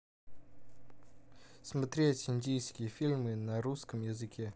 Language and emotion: Russian, neutral